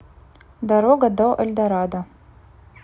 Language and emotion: Russian, neutral